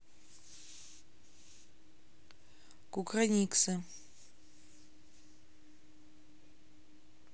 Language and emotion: Russian, neutral